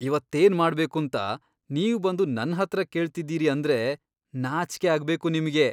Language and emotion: Kannada, disgusted